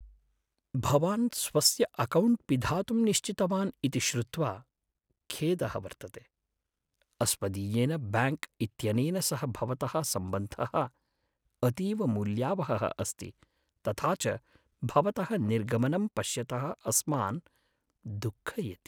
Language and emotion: Sanskrit, sad